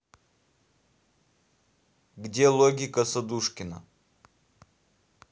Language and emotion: Russian, neutral